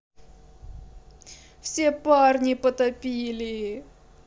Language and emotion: Russian, sad